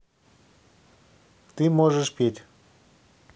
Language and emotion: Russian, neutral